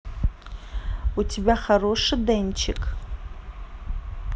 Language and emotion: Russian, neutral